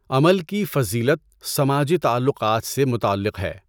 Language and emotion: Urdu, neutral